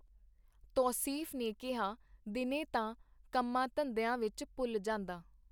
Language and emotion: Punjabi, neutral